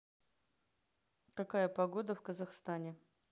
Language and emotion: Russian, neutral